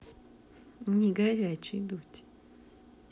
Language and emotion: Russian, neutral